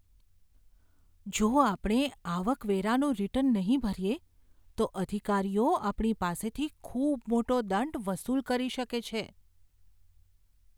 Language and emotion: Gujarati, fearful